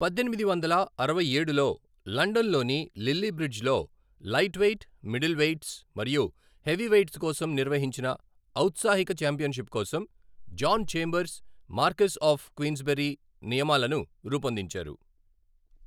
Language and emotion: Telugu, neutral